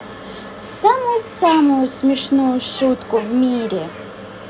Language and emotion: Russian, positive